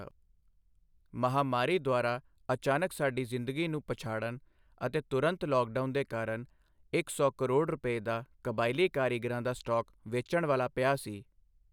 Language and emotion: Punjabi, neutral